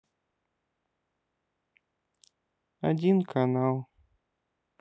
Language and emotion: Russian, sad